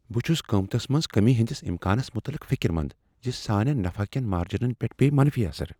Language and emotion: Kashmiri, fearful